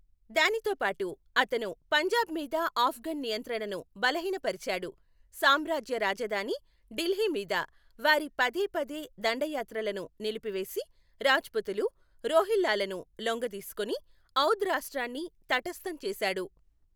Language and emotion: Telugu, neutral